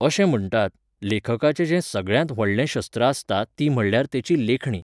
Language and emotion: Goan Konkani, neutral